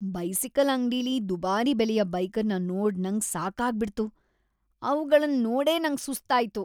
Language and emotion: Kannada, disgusted